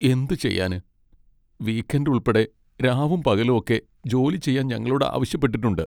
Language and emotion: Malayalam, sad